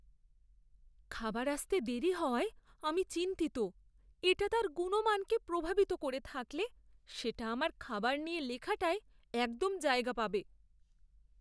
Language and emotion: Bengali, fearful